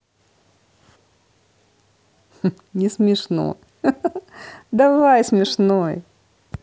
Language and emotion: Russian, positive